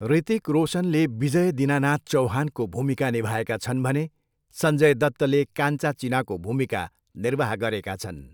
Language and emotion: Nepali, neutral